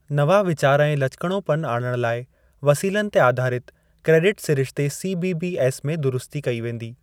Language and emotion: Sindhi, neutral